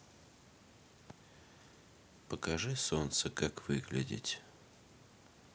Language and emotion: Russian, sad